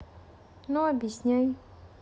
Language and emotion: Russian, neutral